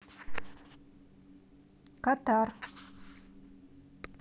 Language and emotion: Russian, neutral